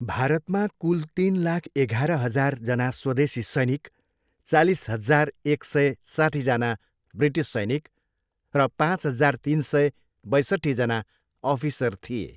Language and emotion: Nepali, neutral